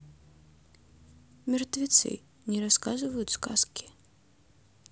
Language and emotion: Russian, neutral